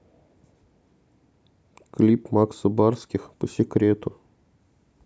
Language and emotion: Russian, neutral